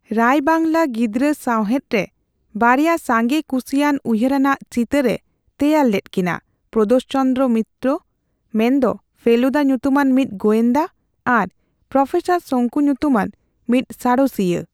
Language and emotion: Santali, neutral